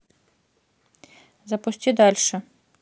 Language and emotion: Russian, neutral